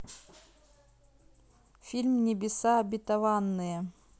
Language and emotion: Russian, neutral